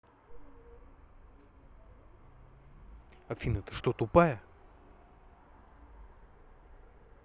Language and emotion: Russian, angry